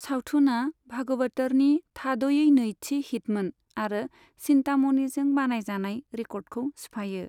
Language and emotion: Bodo, neutral